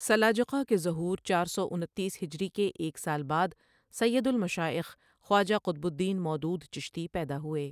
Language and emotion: Urdu, neutral